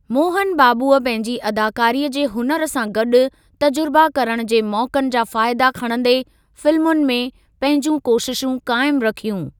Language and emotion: Sindhi, neutral